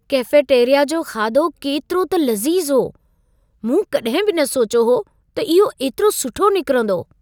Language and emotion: Sindhi, surprised